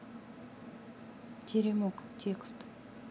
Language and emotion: Russian, neutral